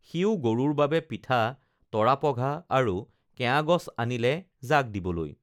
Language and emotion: Assamese, neutral